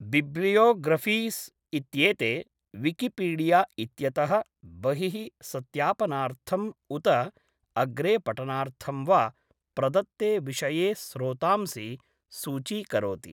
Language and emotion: Sanskrit, neutral